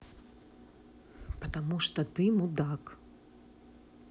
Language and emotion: Russian, angry